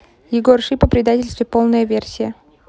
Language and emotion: Russian, neutral